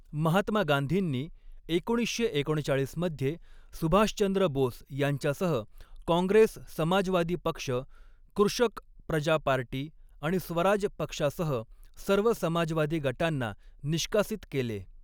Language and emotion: Marathi, neutral